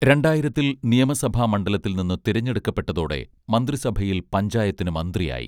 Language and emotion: Malayalam, neutral